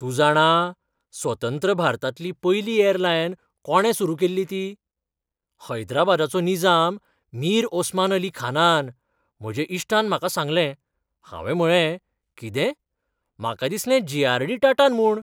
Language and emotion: Goan Konkani, surprised